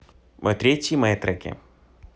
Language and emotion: Russian, neutral